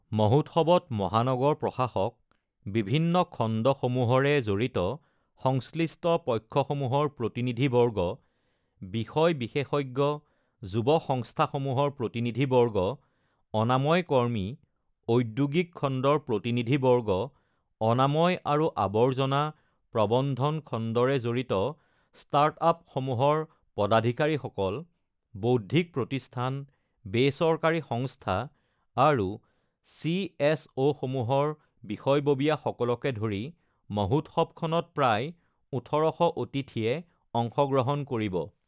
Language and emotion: Assamese, neutral